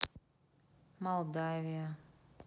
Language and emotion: Russian, sad